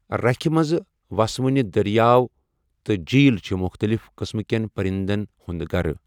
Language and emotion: Kashmiri, neutral